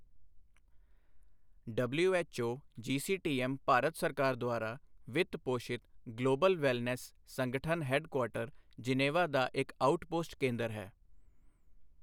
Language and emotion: Punjabi, neutral